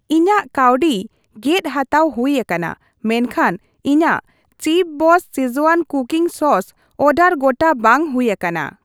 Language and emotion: Santali, neutral